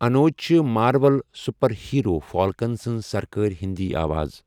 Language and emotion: Kashmiri, neutral